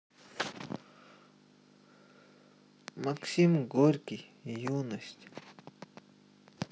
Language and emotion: Russian, sad